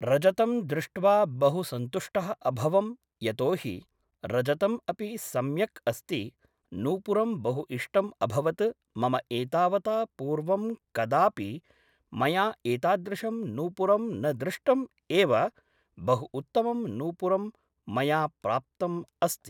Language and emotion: Sanskrit, neutral